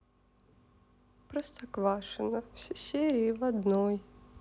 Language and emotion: Russian, sad